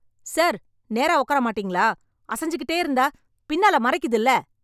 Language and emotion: Tamil, angry